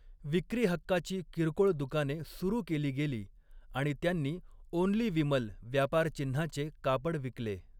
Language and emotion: Marathi, neutral